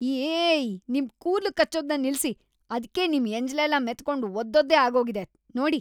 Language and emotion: Kannada, disgusted